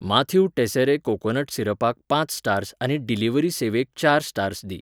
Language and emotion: Goan Konkani, neutral